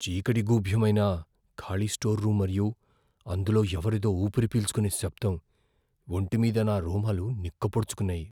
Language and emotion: Telugu, fearful